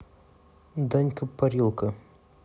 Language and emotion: Russian, neutral